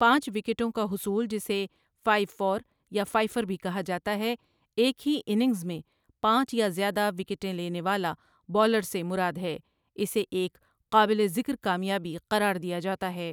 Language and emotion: Urdu, neutral